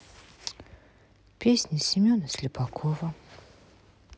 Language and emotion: Russian, sad